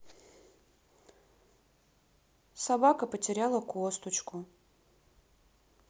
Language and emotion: Russian, sad